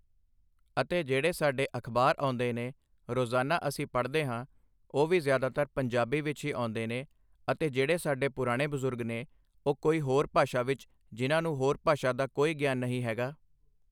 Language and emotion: Punjabi, neutral